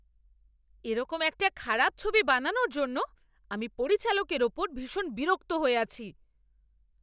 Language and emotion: Bengali, angry